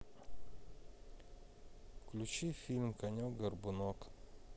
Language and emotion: Russian, neutral